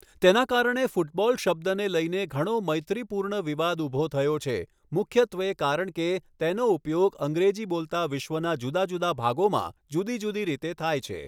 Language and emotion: Gujarati, neutral